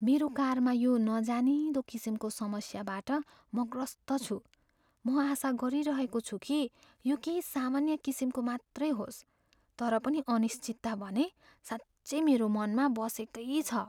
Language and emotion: Nepali, fearful